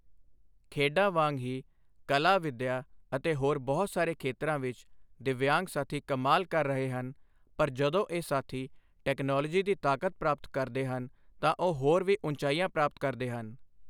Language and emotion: Punjabi, neutral